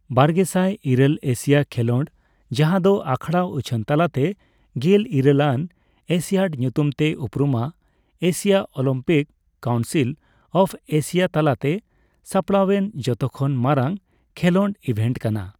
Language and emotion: Santali, neutral